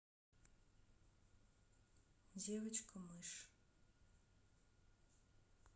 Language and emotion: Russian, neutral